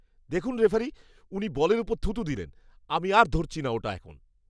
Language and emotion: Bengali, disgusted